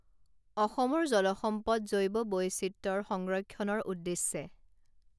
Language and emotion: Assamese, neutral